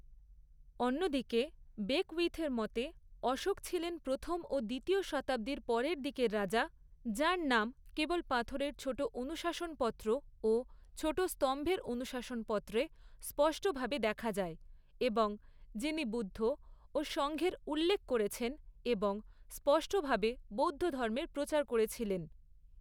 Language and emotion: Bengali, neutral